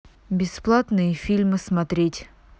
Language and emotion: Russian, neutral